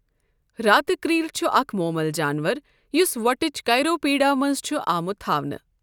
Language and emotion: Kashmiri, neutral